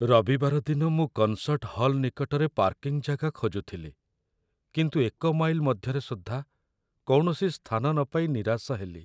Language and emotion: Odia, sad